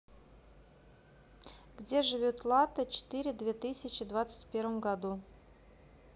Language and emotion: Russian, neutral